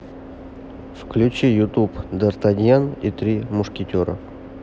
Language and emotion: Russian, neutral